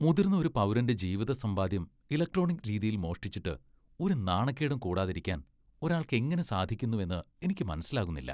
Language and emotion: Malayalam, disgusted